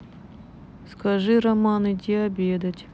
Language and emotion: Russian, neutral